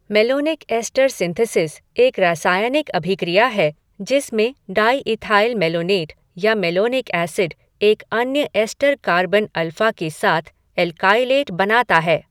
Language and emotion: Hindi, neutral